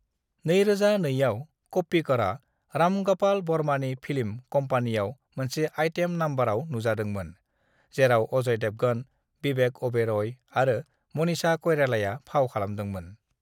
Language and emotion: Bodo, neutral